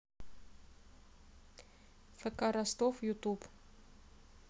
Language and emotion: Russian, neutral